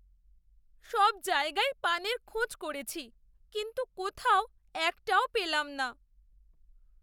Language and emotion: Bengali, sad